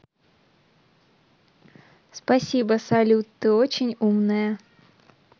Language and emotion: Russian, positive